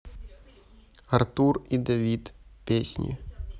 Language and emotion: Russian, neutral